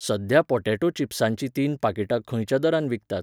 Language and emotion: Goan Konkani, neutral